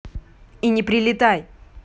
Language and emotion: Russian, angry